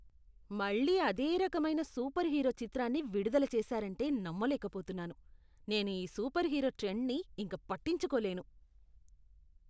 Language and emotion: Telugu, disgusted